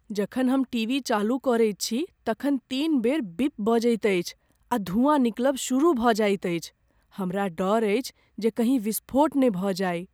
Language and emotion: Maithili, fearful